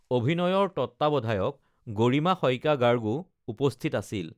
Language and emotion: Assamese, neutral